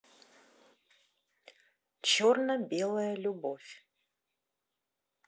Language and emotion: Russian, neutral